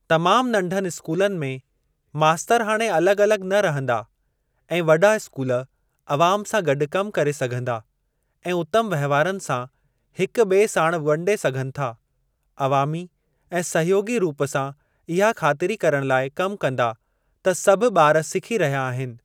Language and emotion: Sindhi, neutral